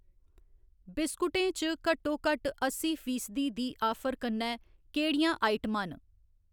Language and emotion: Dogri, neutral